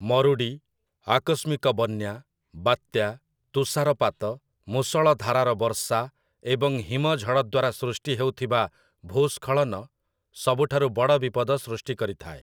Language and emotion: Odia, neutral